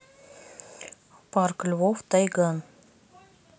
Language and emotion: Russian, neutral